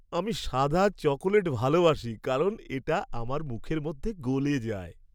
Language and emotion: Bengali, happy